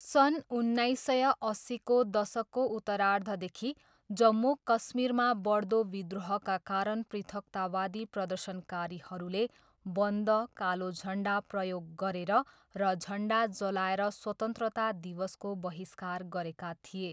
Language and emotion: Nepali, neutral